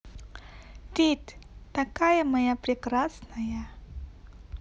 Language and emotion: Russian, positive